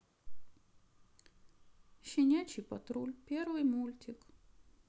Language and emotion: Russian, sad